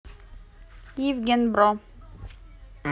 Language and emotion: Russian, neutral